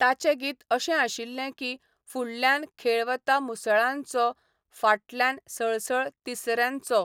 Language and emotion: Goan Konkani, neutral